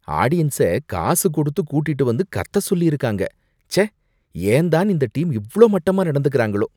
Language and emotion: Tamil, disgusted